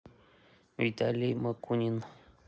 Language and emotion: Russian, neutral